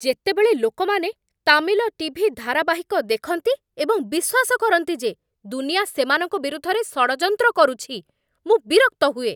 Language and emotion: Odia, angry